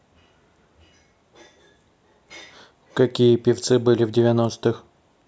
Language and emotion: Russian, neutral